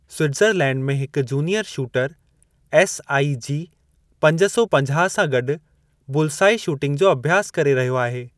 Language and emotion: Sindhi, neutral